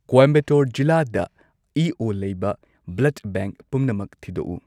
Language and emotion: Manipuri, neutral